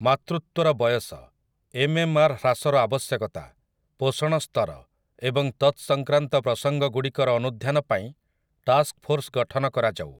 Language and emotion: Odia, neutral